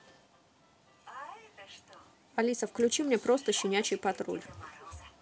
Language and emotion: Russian, neutral